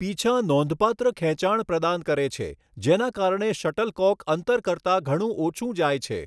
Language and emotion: Gujarati, neutral